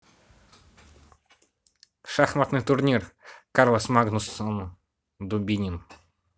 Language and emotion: Russian, neutral